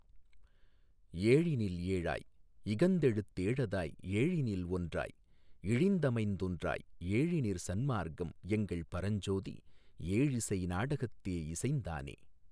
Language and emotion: Tamil, neutral